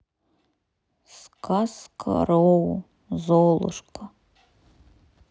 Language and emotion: Russian, sad